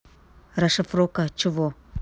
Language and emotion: Russian, neutral